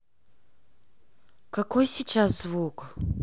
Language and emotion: Russian, neutral